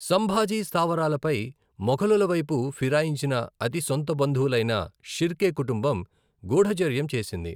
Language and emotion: Telugu, neutral